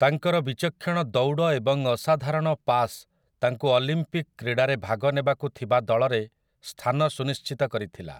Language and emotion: Odia, neutral